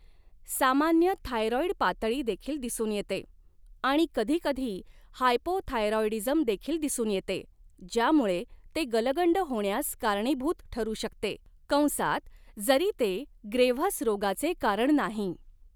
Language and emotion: Marathi, neutral